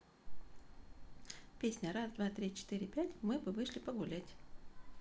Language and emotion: Russian, positive